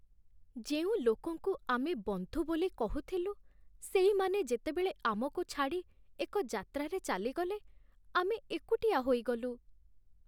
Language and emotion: Odia, sad